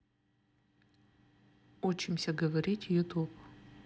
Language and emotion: Russian, neutral